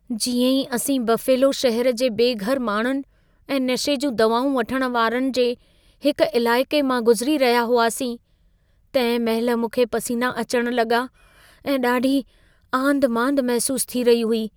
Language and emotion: Sindhi, fearful